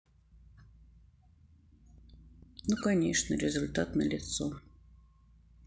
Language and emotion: Russian, sad